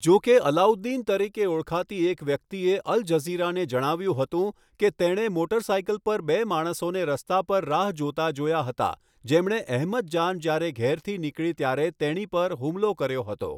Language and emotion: Gujarati, neutral